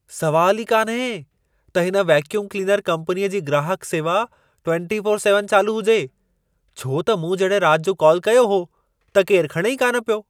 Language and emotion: Sindhi, surprised